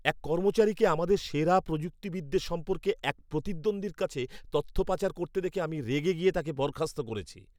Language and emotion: Bengali, angry